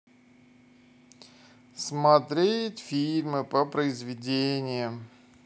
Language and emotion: Russian, neutral